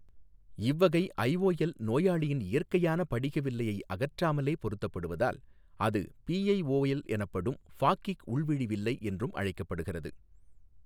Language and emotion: Tamil, neutral